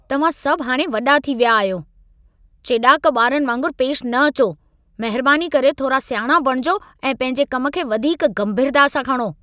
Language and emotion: Sindhi, angry